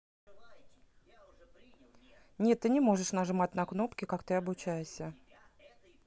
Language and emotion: Russian, neutral